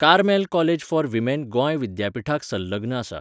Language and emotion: Goan Konkani, neutral